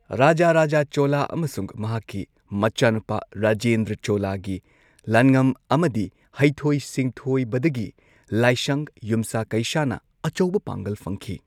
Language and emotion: Manipuri, neutral